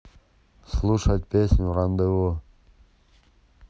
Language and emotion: Russian, neutral